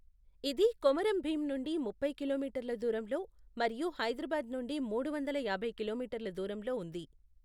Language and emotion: Telugu, neutral